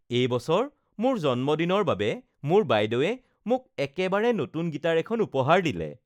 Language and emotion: Assamese, happy